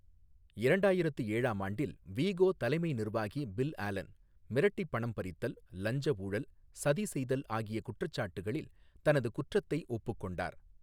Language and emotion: Tamil, neutral